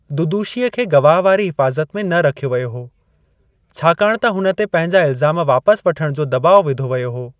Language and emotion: Sindhi, neutral